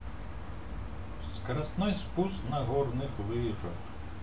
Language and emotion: Russian, neutral